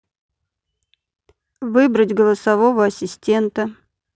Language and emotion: Russian, neutral